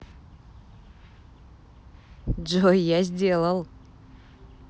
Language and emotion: Russian, positive